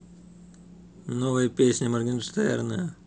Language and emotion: Russian, neutral